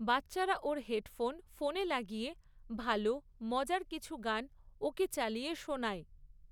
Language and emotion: Bengali, neutral